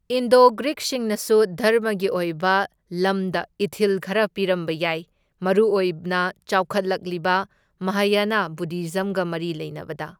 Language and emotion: Manipuri, neutral